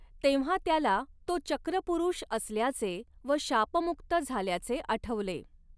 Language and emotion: Marathi, neutral